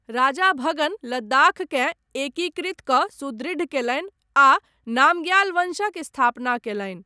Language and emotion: Maithili, neutral